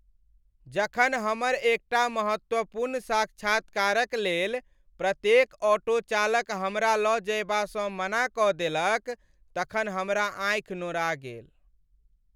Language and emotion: Maithili, sad